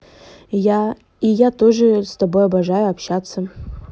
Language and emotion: Russian, neutral